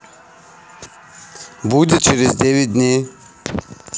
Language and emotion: Russian, neutral